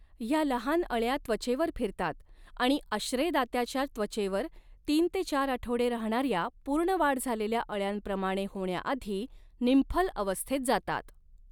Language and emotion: Marathi, neutral